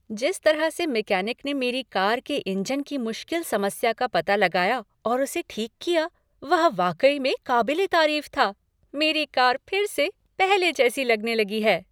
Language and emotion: Hindi, happy